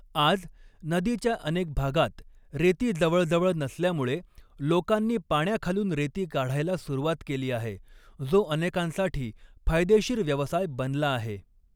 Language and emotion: Marathi, neutral